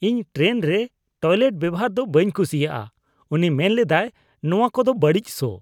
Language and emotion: Santali, disgusted